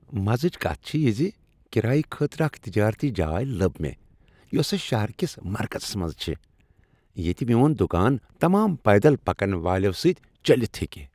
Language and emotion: Kashmiri, happy